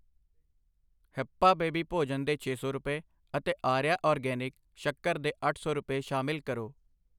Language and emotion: Punjabi, neutral